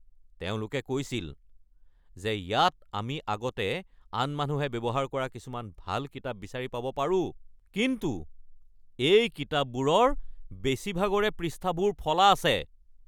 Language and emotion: Assamese, angry